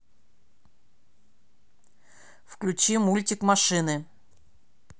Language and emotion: Russian, angry